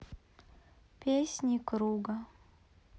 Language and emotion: Russian, sad